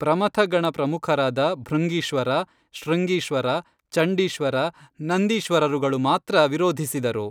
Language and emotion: Kannada, neutral